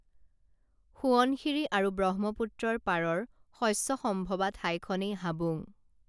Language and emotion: Assamese, neutral